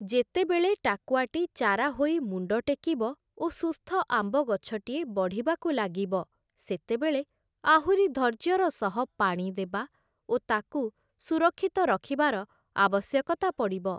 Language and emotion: Odia, neutral